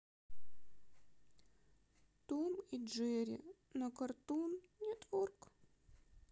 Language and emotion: Russian, sad